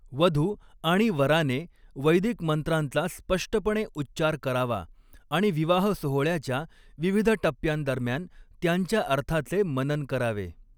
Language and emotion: Marathi, neutral